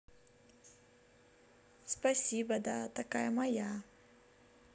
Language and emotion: Russian, positive